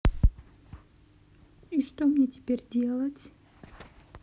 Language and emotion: Russian, sad